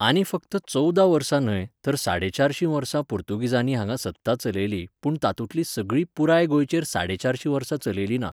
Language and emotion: Goan Konkani, neutral